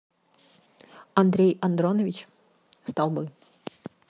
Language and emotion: Russian, neutral